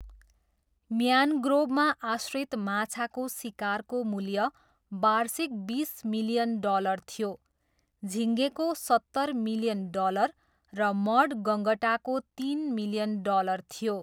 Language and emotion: Nepali, neutral